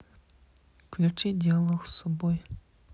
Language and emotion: Russian, neutral